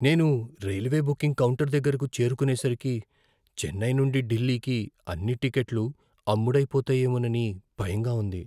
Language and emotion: Telugu, fearful